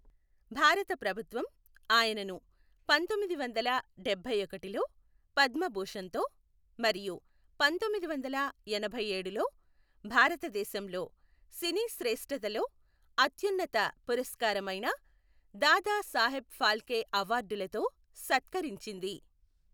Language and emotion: Telugu, neutral